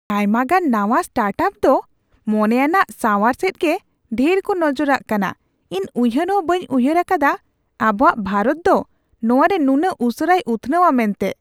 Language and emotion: Santali, surprised